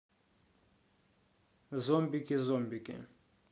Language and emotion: Russian, neutral